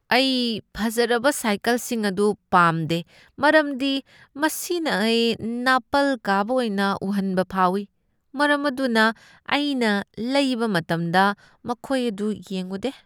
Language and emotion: Manipuri, disgusted